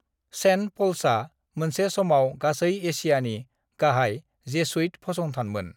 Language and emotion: Bodo, neutral